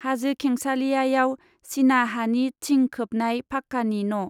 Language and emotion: Bodo, neutral